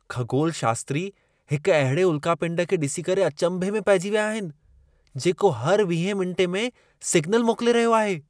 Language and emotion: Sindhi, surprised